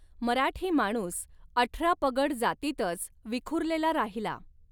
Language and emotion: Marathi, neutral